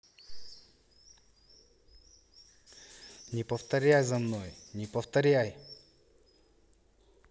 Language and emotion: Russian, angry